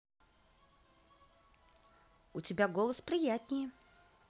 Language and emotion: Russian, positive